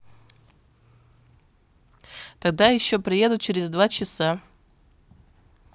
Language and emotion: Russian, neutral